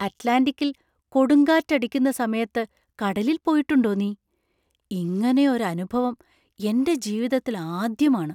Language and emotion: Malayalam, surprised